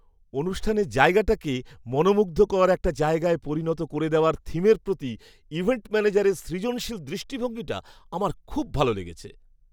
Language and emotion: Bengali, happy